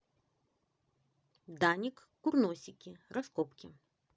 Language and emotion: Russian, positive